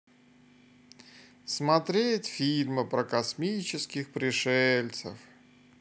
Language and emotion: Russian, sad